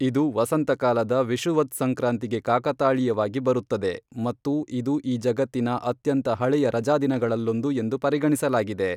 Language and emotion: Kannada, neutral